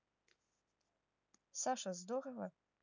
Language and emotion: Russian, neutral